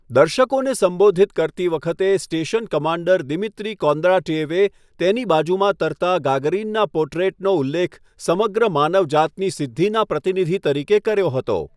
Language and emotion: Gujarati, neutral